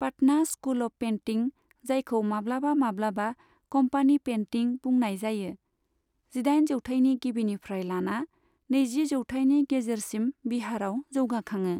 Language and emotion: Bodo, neutral